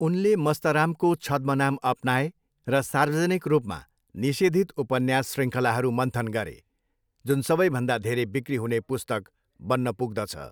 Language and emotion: Nepali, neutral